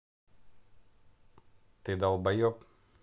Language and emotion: Russian, angry